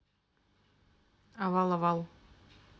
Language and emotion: Russian, neutral